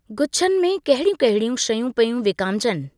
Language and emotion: Sindhi, neutral